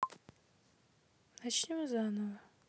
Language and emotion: Russian, neutral